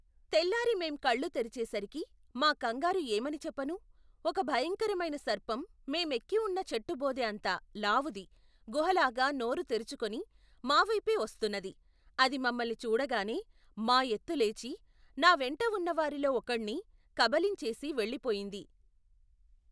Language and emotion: Telugu, neutral